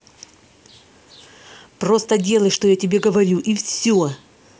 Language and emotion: Russian, angry